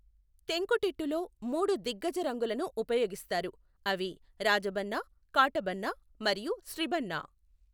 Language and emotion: Telugu, neutral